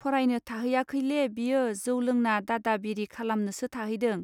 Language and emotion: Bodo, neutral